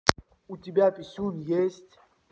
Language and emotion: Russian, neutral